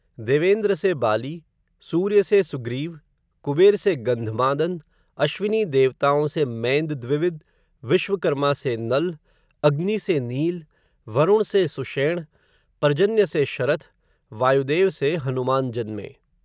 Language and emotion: Hindi, neutral